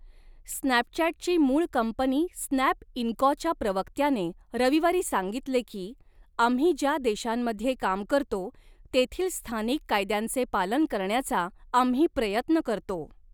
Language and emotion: Marathi, neutral